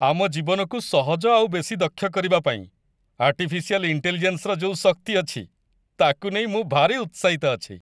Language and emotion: Odia, happy